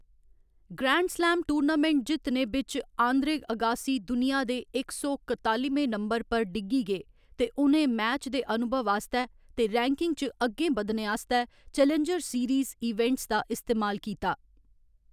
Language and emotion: Dogri, neutral